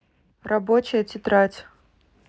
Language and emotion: Russian, neutral